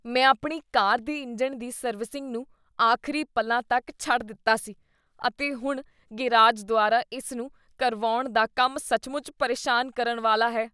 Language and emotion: Punjabi, disgusted